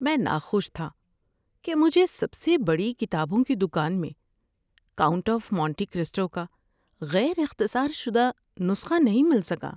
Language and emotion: Urdu, sad